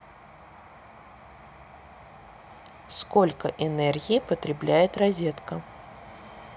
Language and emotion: Russian, neutral